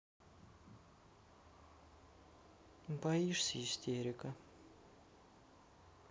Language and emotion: Russian, sad